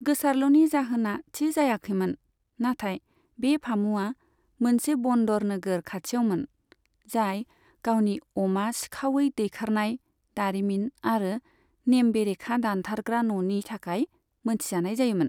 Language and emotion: Bodo, neutral